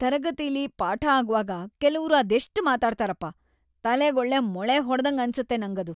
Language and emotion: Kannada, disgusted